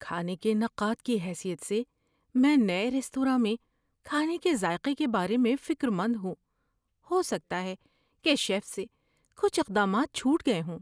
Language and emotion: Urdu, fearful